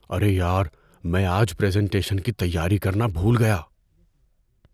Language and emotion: Urdu, fearful